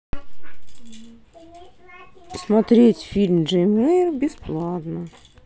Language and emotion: Russian, sad